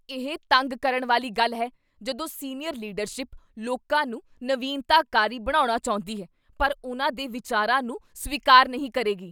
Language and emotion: Punjabi, angry